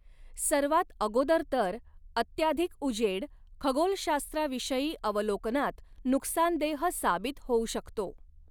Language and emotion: Marathi, neutral